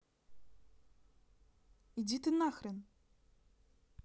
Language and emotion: Russian, angry